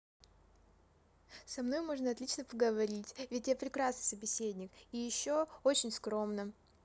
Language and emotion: Russian, positive